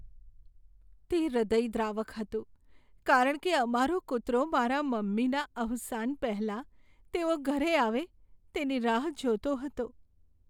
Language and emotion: Gujarati, sad